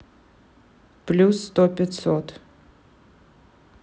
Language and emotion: Russian, neutral